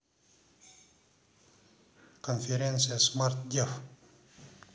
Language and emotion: Russian, neutral